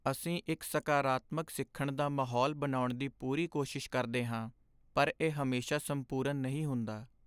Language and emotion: Punjabi, sad